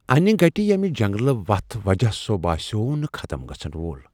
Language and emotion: Kashmiri, fearful